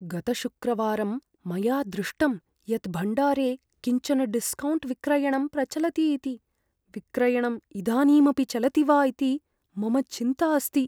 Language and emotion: Sanskrit, fearful